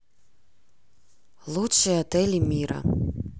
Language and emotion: Russian, neutral